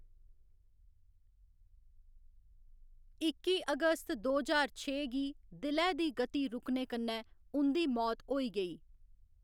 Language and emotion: Dogri, neutral